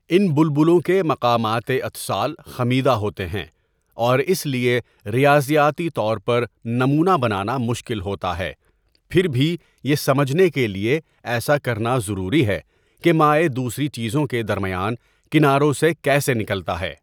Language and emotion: Urdu, neutral